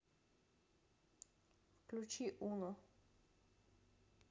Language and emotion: Russian, neutral